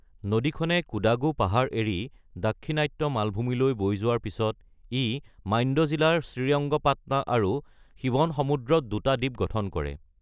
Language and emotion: Assamese, neutral